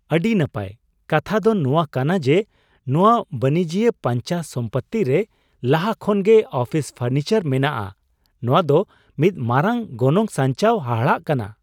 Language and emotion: Santali, surprised